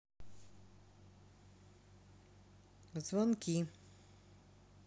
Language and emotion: Russian, neutral